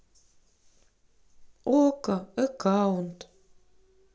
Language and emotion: Russian, neutral